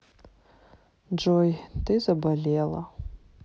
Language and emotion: Russian, sad